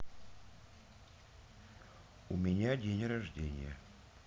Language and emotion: Russian, neutral